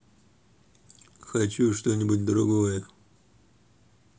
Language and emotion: Russian, angry